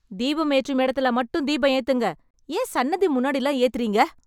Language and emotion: Tamil, angry